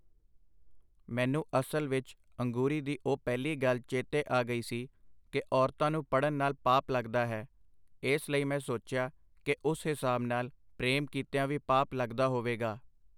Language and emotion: Punjabi, neutral